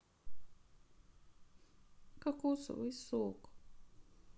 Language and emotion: Russian, sad